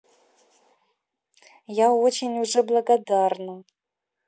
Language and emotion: Russian, positive